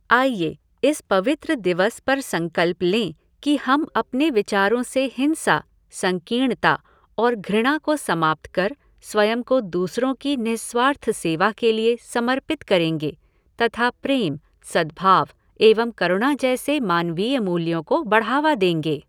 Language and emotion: Hindi, neutral